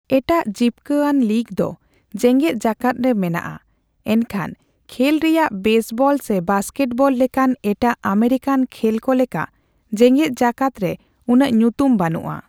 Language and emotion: Santali, neutral